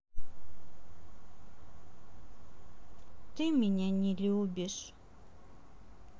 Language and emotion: Russian, sad